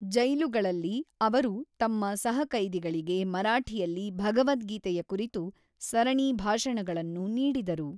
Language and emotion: Kannada, neutral